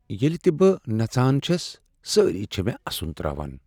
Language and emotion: Kashmiri, sad